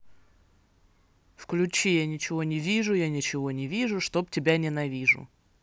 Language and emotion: Russian, neutral